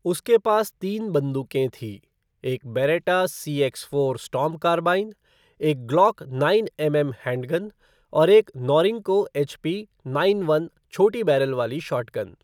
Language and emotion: Hindi, neutral